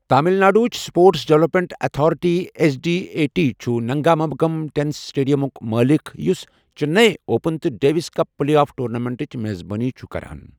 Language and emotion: Kashmiri, neutral